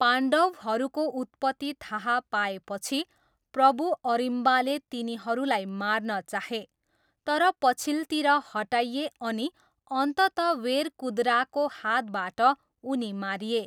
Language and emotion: Nepali, neutral